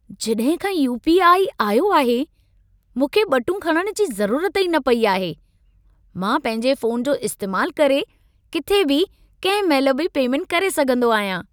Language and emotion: Sindhi, happy